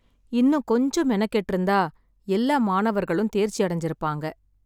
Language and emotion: Tamil, sad